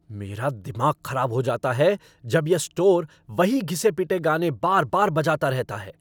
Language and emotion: Hindi, angry